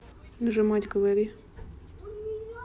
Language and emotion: Russian, neutral